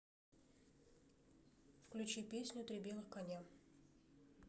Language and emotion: Russian, neutral